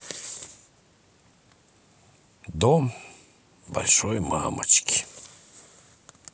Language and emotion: Russian, sad